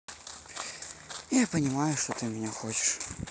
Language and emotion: Russian, sad